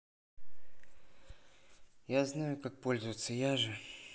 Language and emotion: Russian, neutral